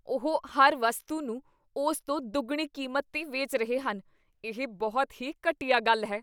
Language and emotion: Punjabi, disgusted